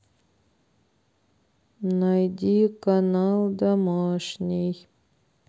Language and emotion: Russian, sad